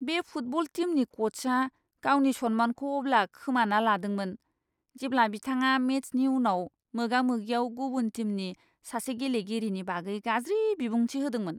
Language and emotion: Bodo, disgusted